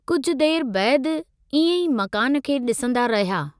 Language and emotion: Sindhi, neutral